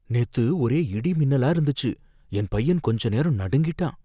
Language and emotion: Tamil, fearful